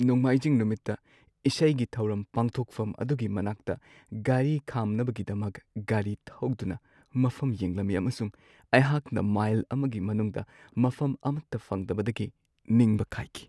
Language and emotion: Manipuri, sad